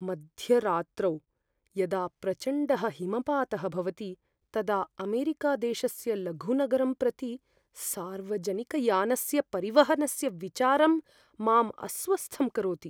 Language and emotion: Sanskrit, fearful